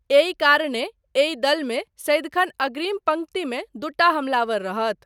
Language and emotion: Maithili, neutral